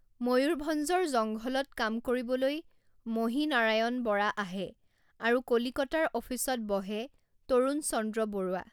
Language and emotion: Assamese, neutral